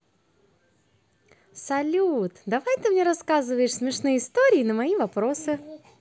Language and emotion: Russian, positive